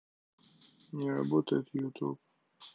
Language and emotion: Russian, neutral